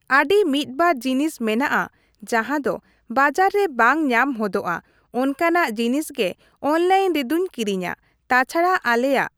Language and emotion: Santali, neutral